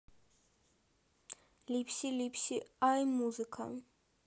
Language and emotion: Russian, neutral